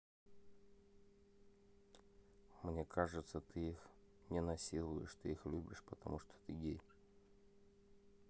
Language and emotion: Russian, neutral